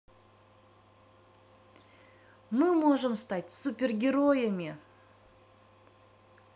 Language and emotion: Russian, positive